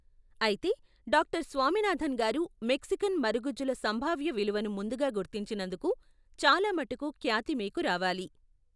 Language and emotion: Telugu, neutral